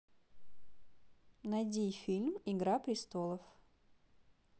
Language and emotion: Russian, neutral